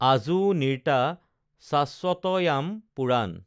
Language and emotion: Assamese, neutral